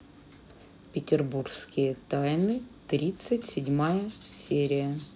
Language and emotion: Russian, neutral